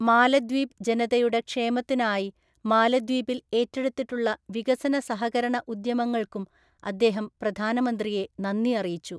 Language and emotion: Malayalam, neutral